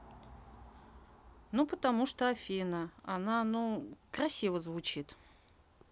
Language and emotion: Russian, neutral